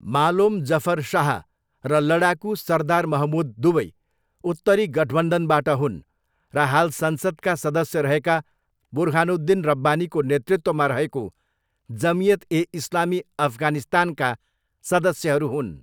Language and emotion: Nepali, neutral